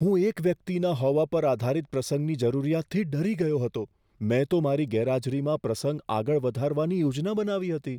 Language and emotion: Gujarati, fearful